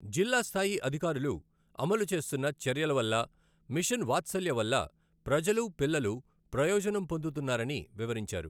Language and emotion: Telugu, neutral